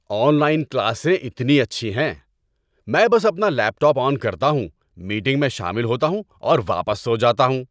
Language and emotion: Urdu, happy